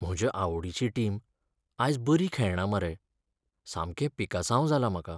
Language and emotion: Goan Konkani, sad